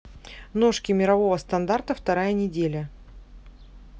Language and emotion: Russian, neutral